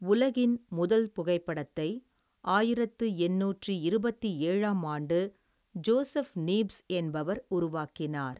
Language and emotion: Tamil, neutral